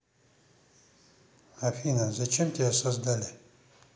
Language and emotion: Russian, neutral